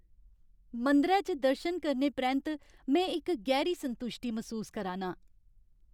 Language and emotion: Dogri, happy